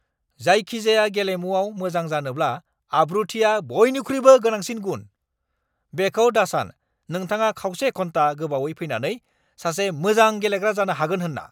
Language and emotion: Bodo, angry